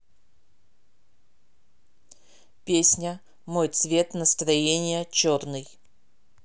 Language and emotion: Russian, neutral